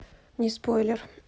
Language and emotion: Russian, neutral